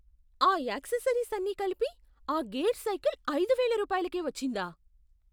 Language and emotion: Telugu, surprised